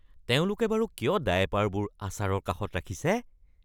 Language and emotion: Assamese, disgusted